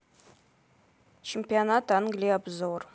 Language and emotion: Russian, neutral